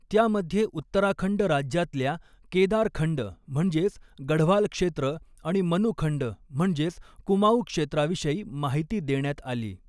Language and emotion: Marathi, neutral